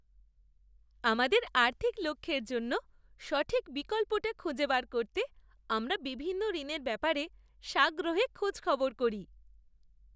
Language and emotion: Bengali, happy